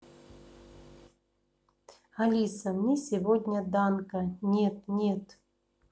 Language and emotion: Russian, neutral